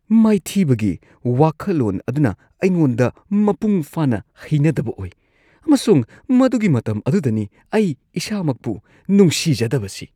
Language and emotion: Manipuri, disgusted